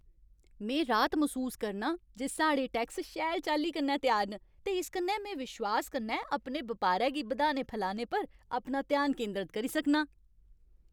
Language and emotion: Dogri, happy